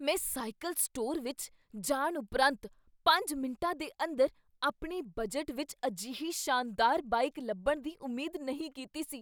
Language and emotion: Punjabi, surprised